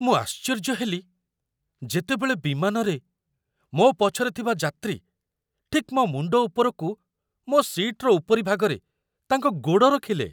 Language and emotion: Odia, surprised